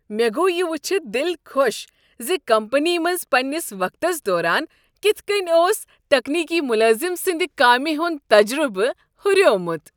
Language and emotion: Kashmiri, happy